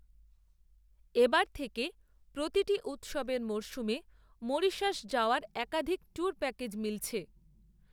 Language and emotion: Bengali, neutral